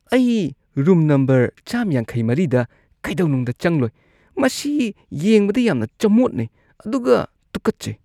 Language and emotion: Manipuri, disgusted